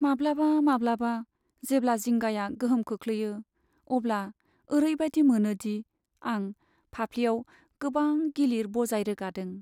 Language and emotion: Bodo, sad